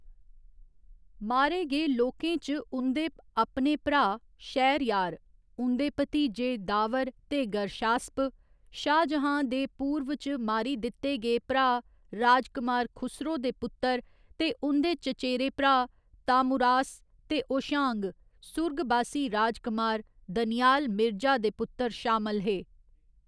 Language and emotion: Dogri, neutral